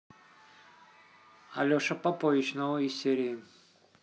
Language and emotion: Russian, neutral